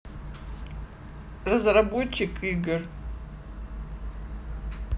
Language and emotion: Russian, neutral